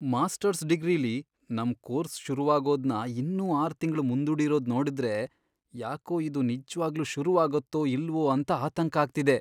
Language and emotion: Kannada, fearful